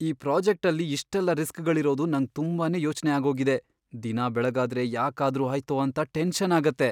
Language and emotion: Kannada, fearful